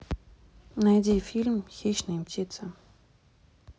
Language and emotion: Russian, neutral